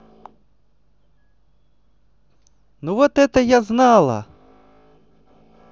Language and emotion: Russian, positive